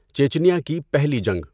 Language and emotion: Urdu, neutral